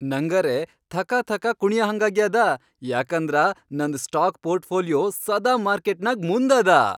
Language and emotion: Kannada, happy